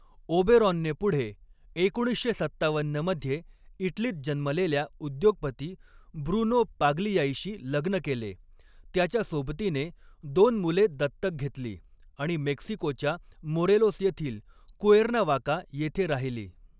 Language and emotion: Marathi, neutral